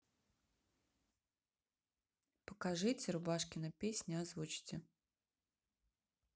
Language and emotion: Russian, neutral